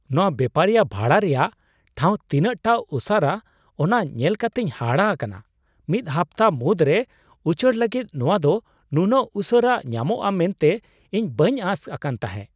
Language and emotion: Santali, surprised